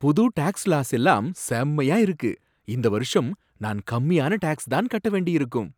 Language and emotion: Tamil, surprised